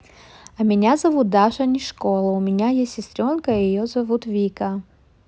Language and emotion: Russian, neutral